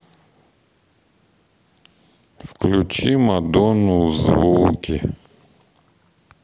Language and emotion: Russian, neutral